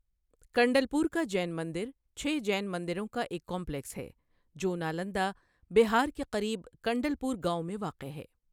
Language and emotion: Urdu, neutral